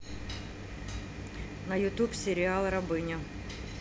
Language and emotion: Russian, neutral